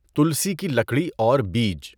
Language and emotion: Urdu, neutral